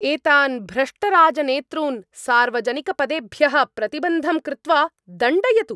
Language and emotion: Sanskrit, angry